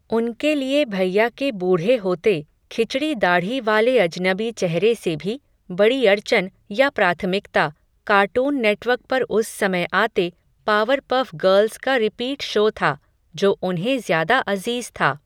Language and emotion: Hindi, neutral